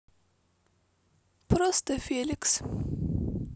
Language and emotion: Russian, neutral